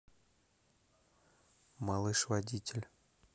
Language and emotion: Russian, neutral